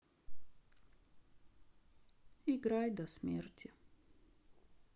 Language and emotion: Russian, sad